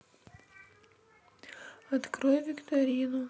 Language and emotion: Russian, sad